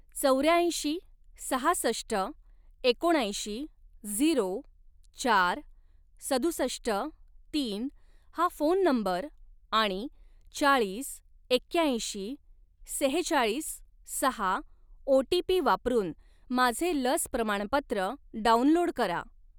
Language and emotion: Marathi, neutral